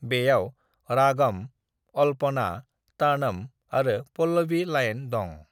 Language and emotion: Bodo, neutral